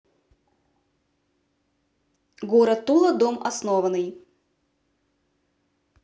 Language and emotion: Russian, neutral